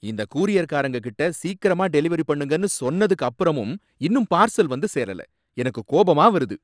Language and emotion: Tamil, angry